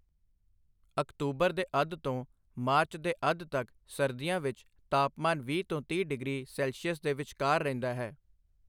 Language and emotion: Punjabi, neutral